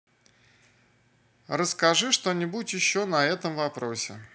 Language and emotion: Russian, neutral